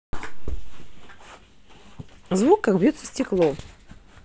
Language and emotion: Russian, positive